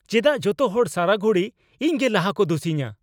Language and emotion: Santali, angry